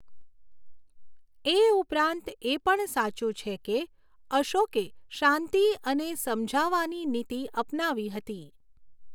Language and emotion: Gujarati, neutral